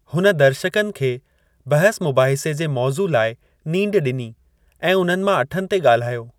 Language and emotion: Sindhi, neutral